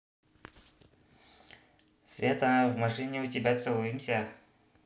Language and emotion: Russian, neutral